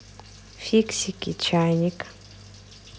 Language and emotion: Russian, neutral